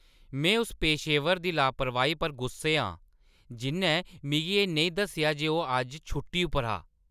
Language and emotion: Dogri, angry